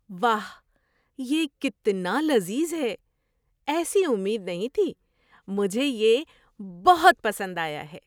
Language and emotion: Urdu, surprised